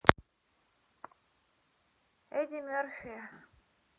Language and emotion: Russian, neutral